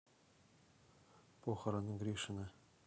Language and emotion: Russian, neutral